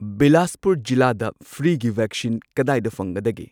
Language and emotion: Manipuri, neutral